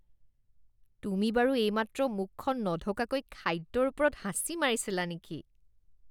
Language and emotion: Assamese, disgusted